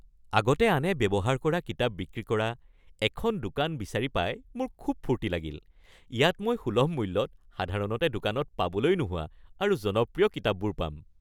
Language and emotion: Assamese, happy